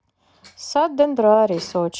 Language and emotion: Russian, sad